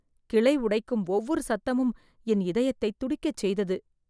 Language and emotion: Tamil, fearful